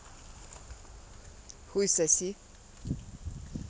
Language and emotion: Russian, neutral